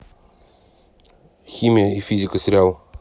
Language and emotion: Russian, neutral